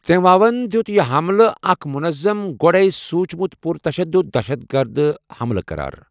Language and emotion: Kashmiri, neutral